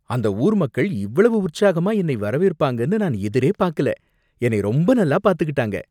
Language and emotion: Tamil, surprised